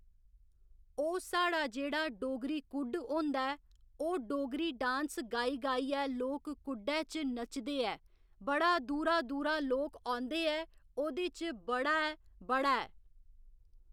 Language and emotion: Dogri, neutral